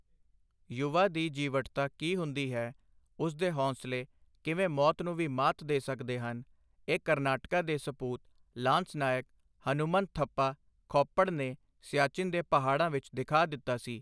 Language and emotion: Punjabi, neutral